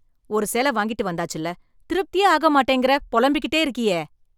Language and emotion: Tamil, angry